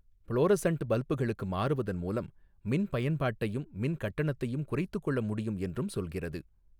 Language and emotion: Tamil, neutral